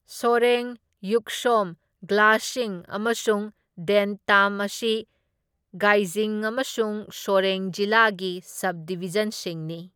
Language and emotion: Manipuri, neutral